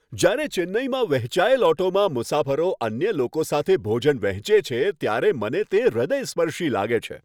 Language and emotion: Gujarati, happy